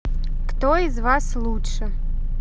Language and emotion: Russian, neutral